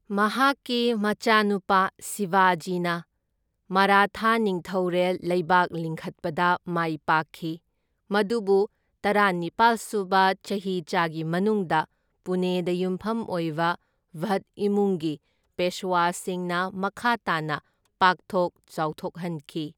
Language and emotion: Manipuri, neutral